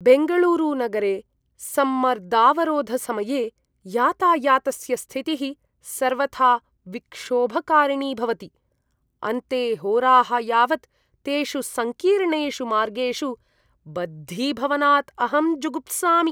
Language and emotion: Sanskrit, disgusted